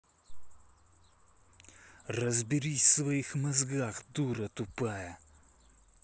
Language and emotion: Russian, angry